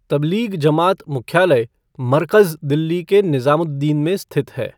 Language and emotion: Hindi, neutral